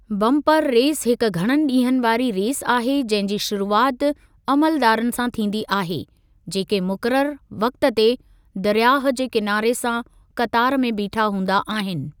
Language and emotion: Sindhi, neutral